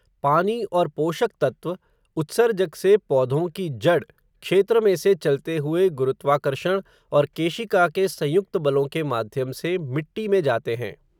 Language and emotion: Hindi, neutral